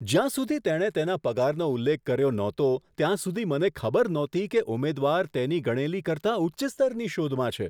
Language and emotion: Gujarati, surprised